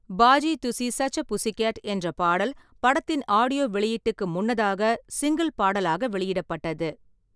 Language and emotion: Tamil, neutral